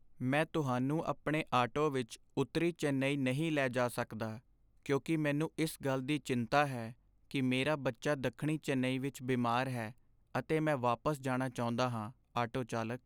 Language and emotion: Punjabi, sad